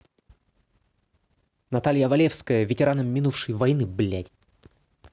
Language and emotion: Russian, angry